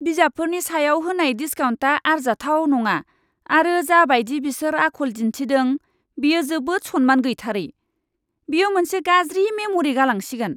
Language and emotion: Bodo, disgusted